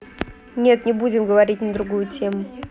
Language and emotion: Russian, neutral